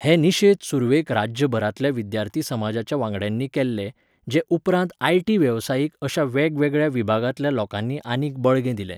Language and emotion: Goan Konkani, neutral